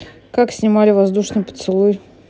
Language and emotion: Russian, neutral